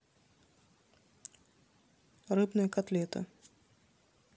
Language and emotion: Russian, neutral